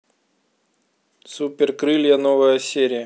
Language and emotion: Russian, neutral